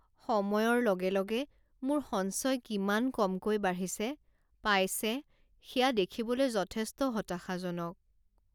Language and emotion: Assamese, sad